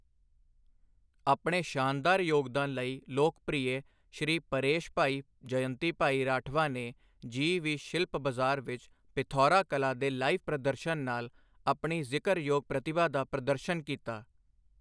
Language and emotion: Punjabi, neutral